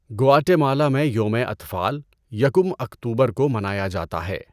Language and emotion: Urdu, neutral